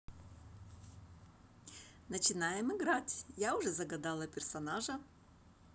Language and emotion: Russian, positive